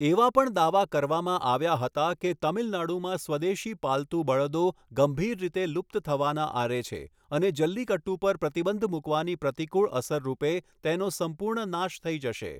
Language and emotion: Gujarati, neutral